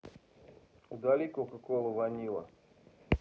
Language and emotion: Russian, neutral